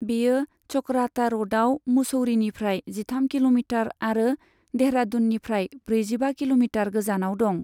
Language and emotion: Bodo, neutral